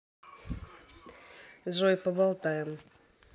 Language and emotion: Russian, neutral